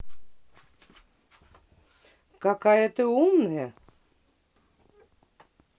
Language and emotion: Russian, neutral